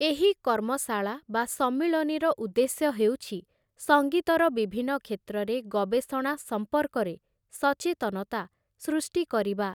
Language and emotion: Odia, neutral